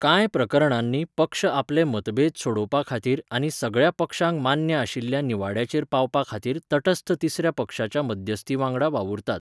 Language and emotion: Goan Konkani, neutral